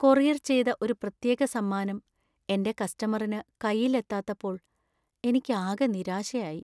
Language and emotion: Malayalam, sad